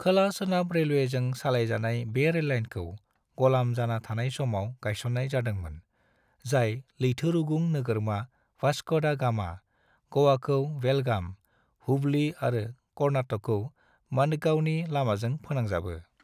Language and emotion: Bodo, neutral